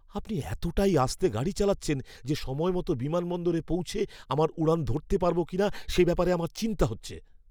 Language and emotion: Bengali, fearful